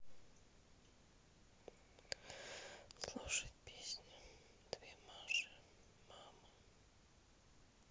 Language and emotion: Russian, sad